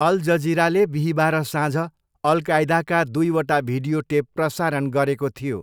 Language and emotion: Nepali, neutral